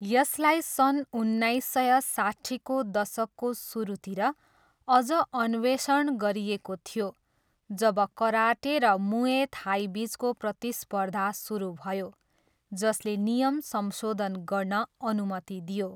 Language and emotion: Nepali, neutral